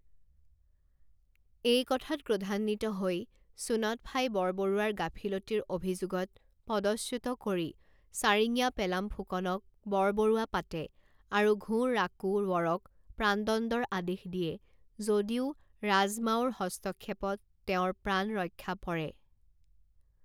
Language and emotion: Assamese, neutral